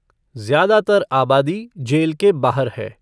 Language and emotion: Hindi, neutral